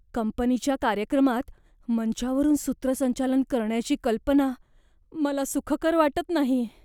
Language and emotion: Marathi, fearful